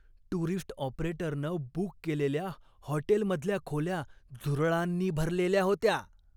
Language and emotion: Marathi, disgusted